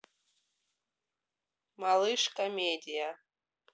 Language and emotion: Russian, neutral